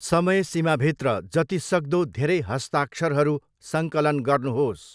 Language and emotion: Nepali, neutral